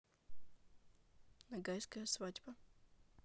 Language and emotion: Russian, neutral